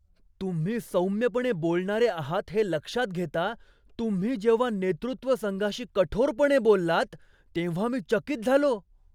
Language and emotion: Marathi, surprised